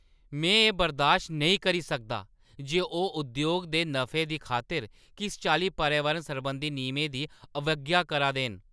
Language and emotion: Dogri, angry